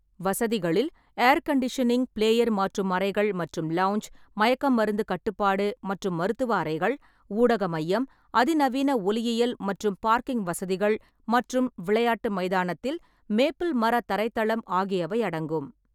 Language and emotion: Tamil, neutral